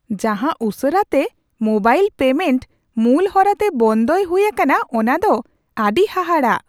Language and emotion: Santali, surprised